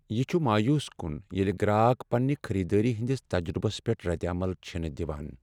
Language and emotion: Kashmiri, sad